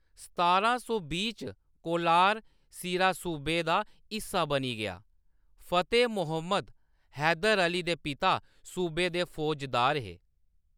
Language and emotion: Dogri, neutral